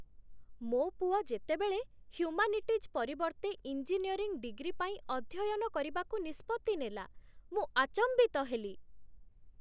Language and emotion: Odia, surprised